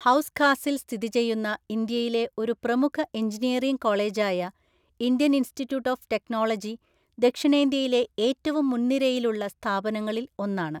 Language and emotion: Malayalam, neutral